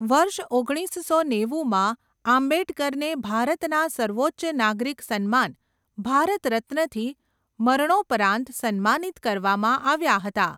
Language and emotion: Gujarati, neutral